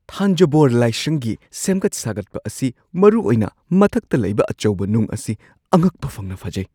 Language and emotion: Manipuri, surprised